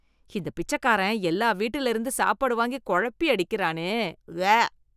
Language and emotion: Tamil, disgusted